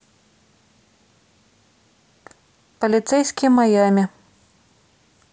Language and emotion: Russian, neutral